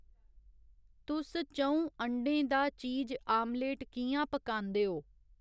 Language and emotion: Dogri, neutral